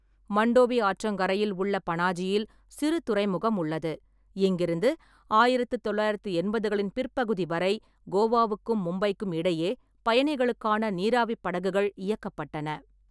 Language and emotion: Tamil, neutral